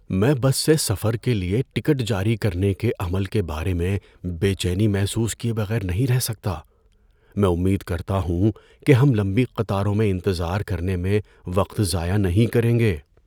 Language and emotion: Urdu, fearful